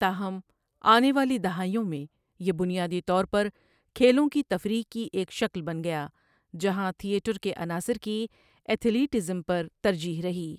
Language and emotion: Urdu, neutral